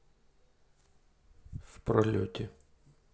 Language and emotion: Russian, neutral